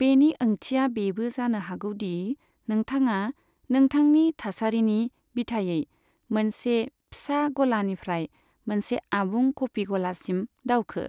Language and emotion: Bodo, neutral